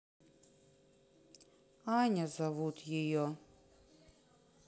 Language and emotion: Russian, sad